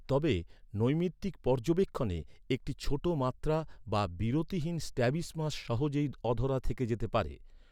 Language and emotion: Bengali, neutral